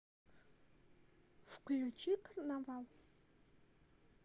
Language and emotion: Russian, neutral